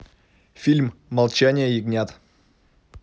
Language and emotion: Russian, neutral